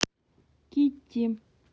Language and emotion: Russian, neutral